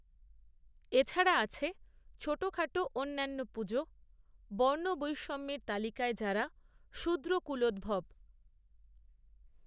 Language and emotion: Bengali, neutral